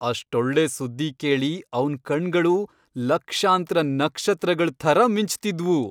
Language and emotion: Kannada, happy